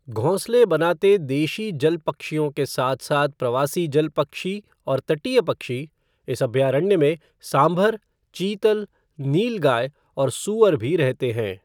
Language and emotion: Hindi, neutral